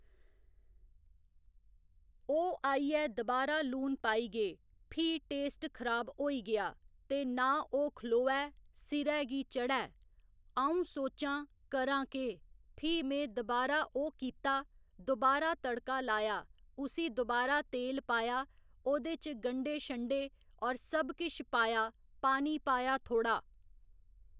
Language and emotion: Dogri, neutral